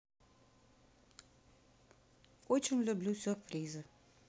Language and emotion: Russian, neutral